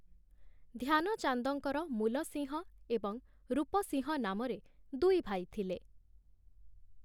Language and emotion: Odia, neutral